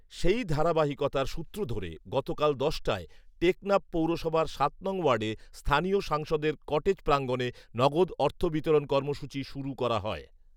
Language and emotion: Bengali, neutral